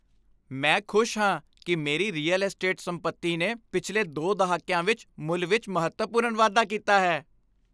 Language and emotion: Punjabi, happy